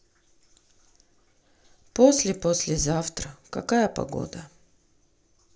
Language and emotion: Russian, sad